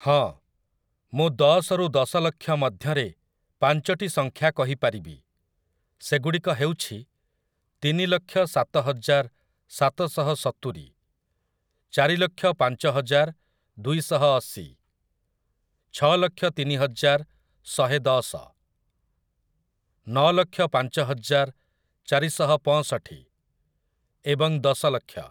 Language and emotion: Odia, neutral